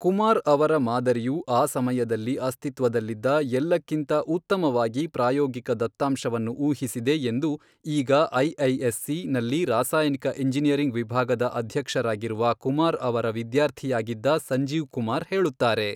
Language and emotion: Kannada, neutral